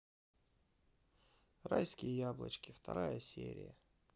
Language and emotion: Russian, sad